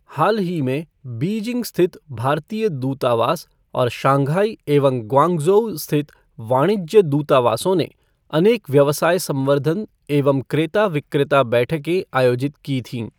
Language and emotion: Hindi, neutral